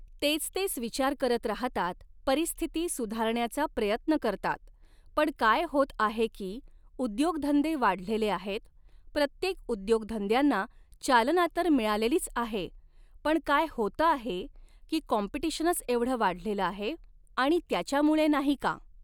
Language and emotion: Marathi, neutral